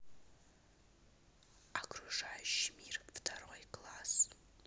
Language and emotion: Russian, neutral